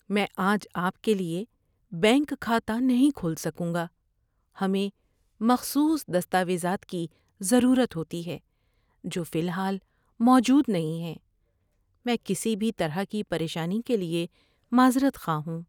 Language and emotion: Urdu, sad